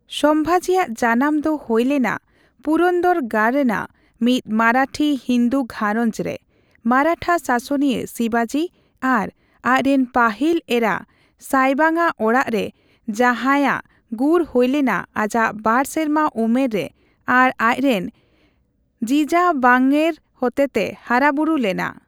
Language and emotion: Santali, neutral